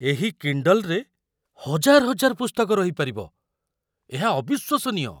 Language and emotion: Odia, surprised